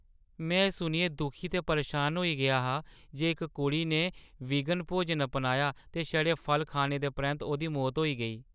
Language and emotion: Dogri, sad